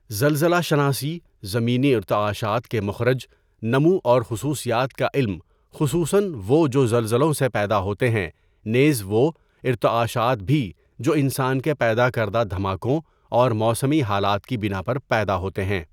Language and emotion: Urdu, neutral